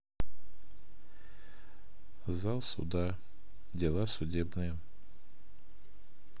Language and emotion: Russian, neutral